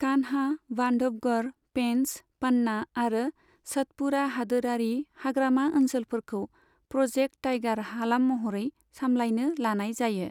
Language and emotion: Bodo, neutral